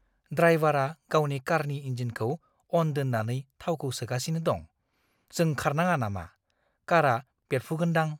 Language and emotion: Bodo, fearful